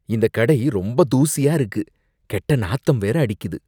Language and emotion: Tamil, disgusted